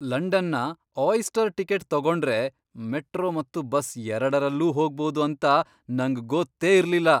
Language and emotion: Kannada, surprised